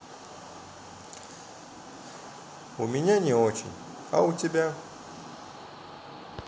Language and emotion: Russian, sad